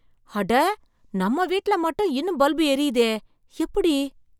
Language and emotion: Tamil, surprised